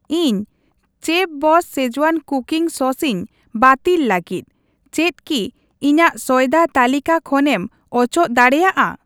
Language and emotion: Santali, neutral